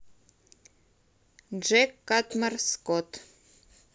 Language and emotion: Russian, neutral